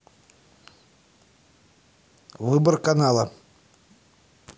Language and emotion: Russian, neutral